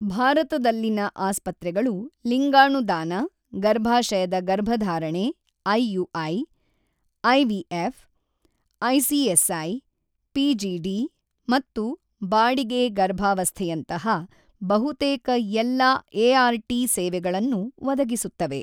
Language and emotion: Kannada, neutral